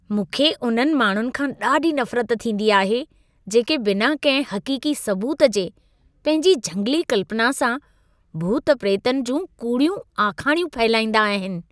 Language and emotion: Sindhi, disgusted